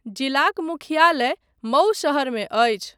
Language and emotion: Maithili, neutral